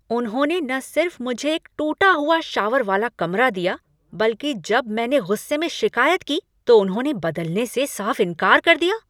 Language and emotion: Hindi, angry